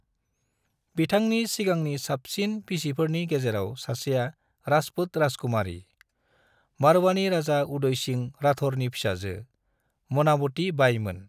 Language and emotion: Bodo, neutral